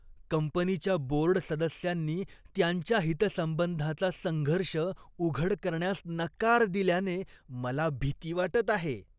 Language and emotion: Marathi, disgusted